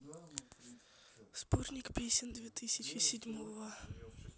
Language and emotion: Russian, neutral